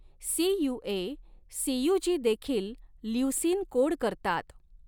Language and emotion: Marathi, neutral